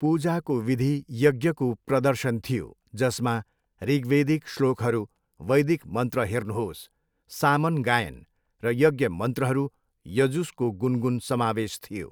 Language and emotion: Nepali, neutral